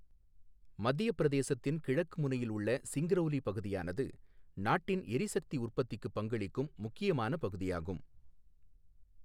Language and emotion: Tamil, neutral